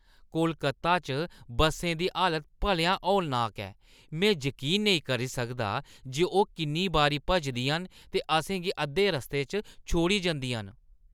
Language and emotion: Dogri, disgusted